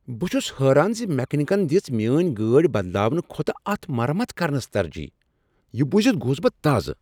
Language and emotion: Kashmiri, surprised